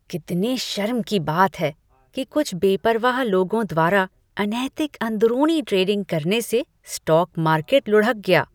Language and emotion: Hindi, disgusted